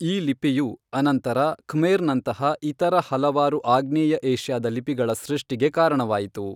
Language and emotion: Kannada, neutral